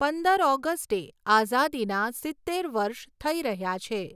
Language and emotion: Gujarati, neutral